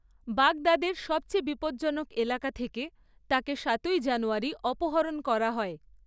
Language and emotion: Bengali, neutral